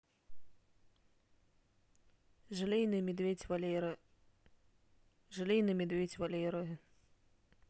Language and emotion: Russian, neutral